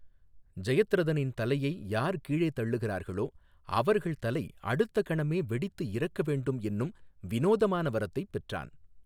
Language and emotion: Tamil, neutral